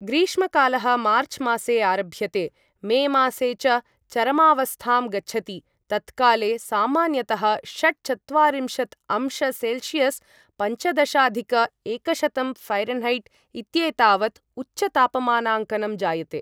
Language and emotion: Sanskrit, neutral